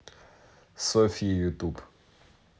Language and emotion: Russian, neutral